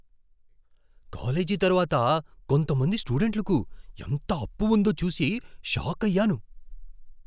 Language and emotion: Telugu, surprised